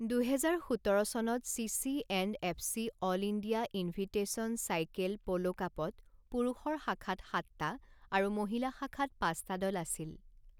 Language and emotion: Assamese, neutral